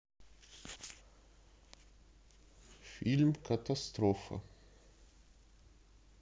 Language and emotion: Russian, neutral